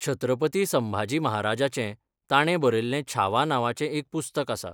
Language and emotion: Goan Konkani, neutral